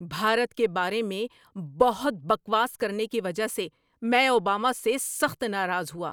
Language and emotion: Urdu, angry